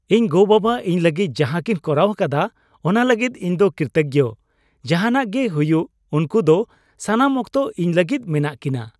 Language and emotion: Santali, happy